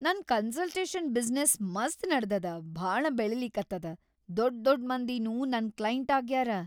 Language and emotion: Kannada, happy